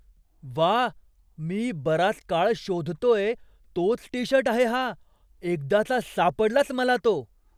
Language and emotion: Marathi, surprised